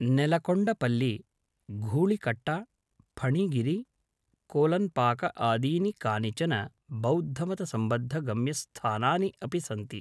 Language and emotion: Sanskrit, neutral